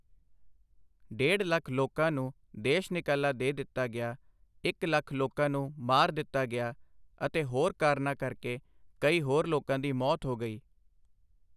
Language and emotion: Punjabi, neutral